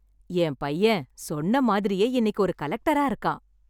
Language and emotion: Tamil, happy